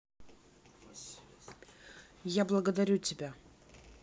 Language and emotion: Russian, neutral